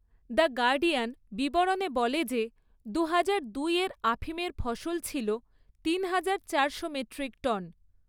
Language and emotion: Bengali, neutral